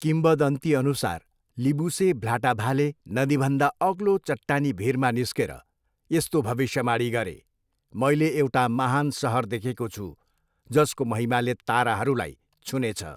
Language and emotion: Nepali, neutral